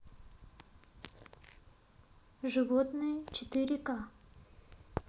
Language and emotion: Russian, neutral